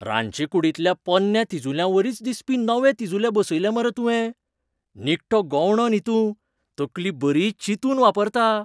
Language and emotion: Goan Konkani, surprised